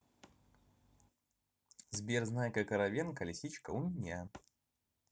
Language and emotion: Russian, neutral